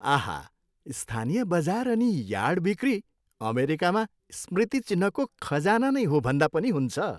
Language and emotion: Nepali, happy